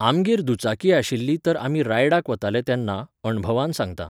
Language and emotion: Goan Konkani, neutral